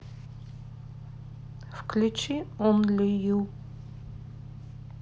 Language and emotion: Russian, neutral